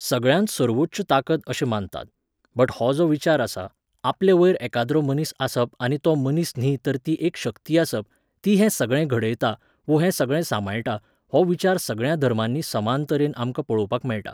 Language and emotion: Goan Konkani, neutral